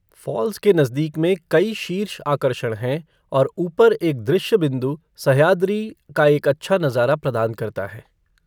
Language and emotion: Hindi, neutral